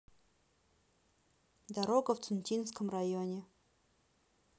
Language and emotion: Russian, neutral